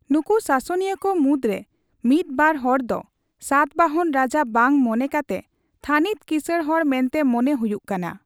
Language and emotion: Santali, neutral